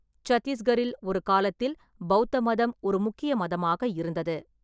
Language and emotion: Tamil, neutral